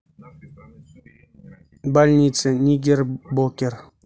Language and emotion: Russian, neutral